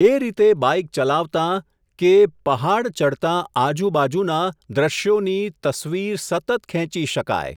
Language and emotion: Gujarati, neutral